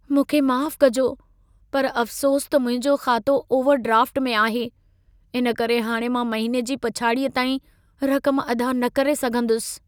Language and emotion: Sindhi, sad